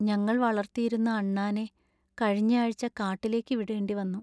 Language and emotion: Malayalam, sad